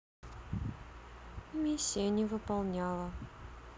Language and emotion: Russian, sad